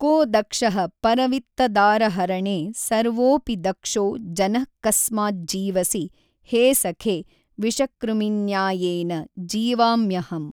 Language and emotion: Kannada, neutral